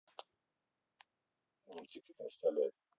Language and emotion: Russian, neutral